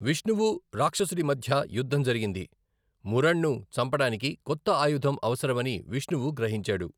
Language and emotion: Telugu, neutral